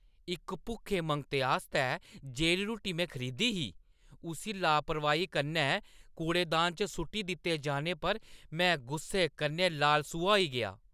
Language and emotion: Dogri, angry